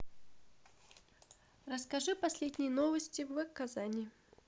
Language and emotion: Russian, neutral